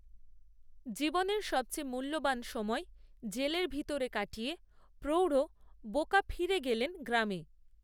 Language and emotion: Bengali, neutral